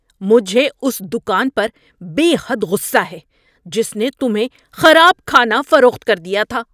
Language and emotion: Urdu, angry